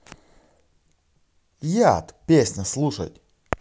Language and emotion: Russian, positive